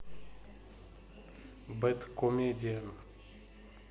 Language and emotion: Russian, neutral